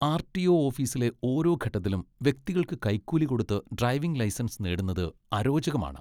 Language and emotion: Malayalam, disgusted